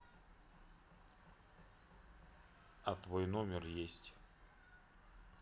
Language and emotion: Russian, neutral